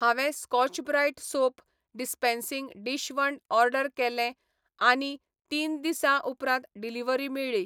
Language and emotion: Goan Konkani, neutral